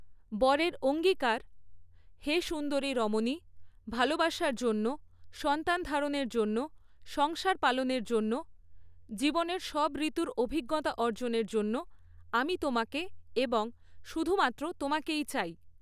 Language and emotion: Bengali, neutral